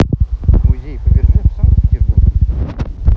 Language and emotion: Russian, neutral